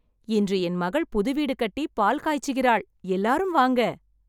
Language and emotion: Tamil, happy